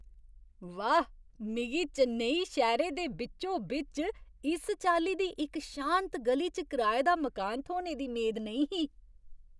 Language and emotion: Dogri, surprised